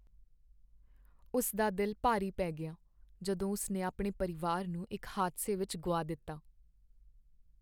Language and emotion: Punjabi, sad